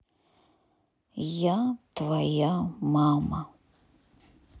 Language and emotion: Russian, sad